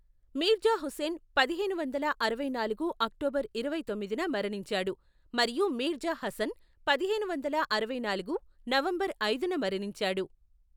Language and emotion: Telugu, neutral